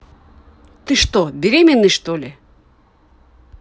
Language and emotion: Russian, angry